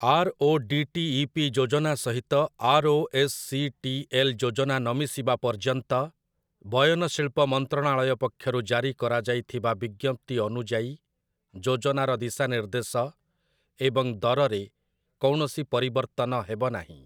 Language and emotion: Odia, neutral